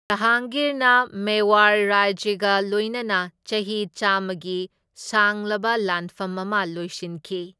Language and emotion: Manipuri, neutral